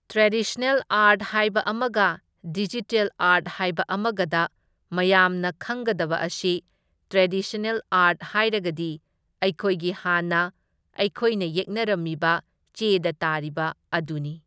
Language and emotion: Manipuri, neutral